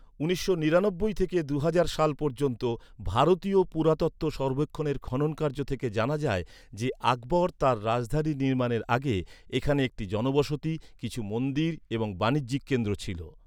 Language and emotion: Bengali, neutral